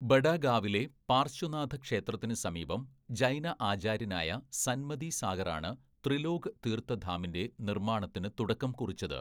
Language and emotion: Malayalam, neutral